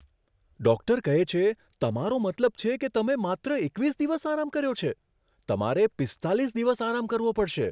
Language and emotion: Gujarati, surprised